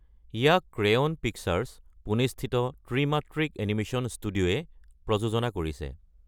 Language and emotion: Assamese, neutral